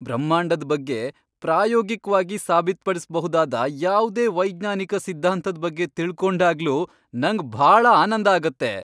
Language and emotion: Kannada, happy